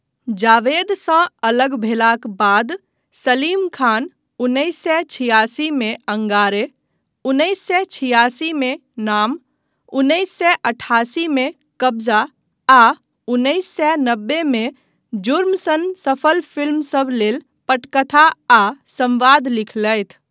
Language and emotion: Maithili, neutral